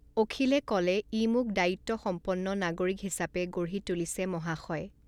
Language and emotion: Assamese, neutral